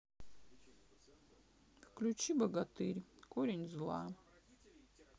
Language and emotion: Russian, sad